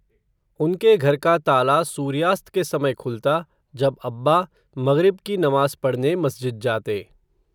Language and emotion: Hindi, neutral